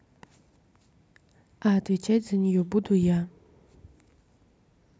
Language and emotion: Russian, neutral